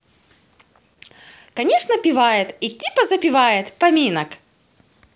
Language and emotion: Russian, positive